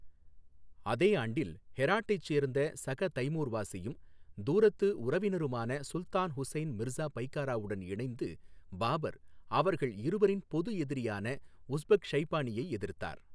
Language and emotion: Tamil, neutral